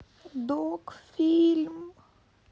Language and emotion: Russian, sad